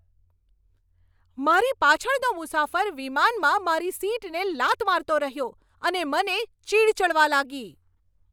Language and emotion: Gujarati, angry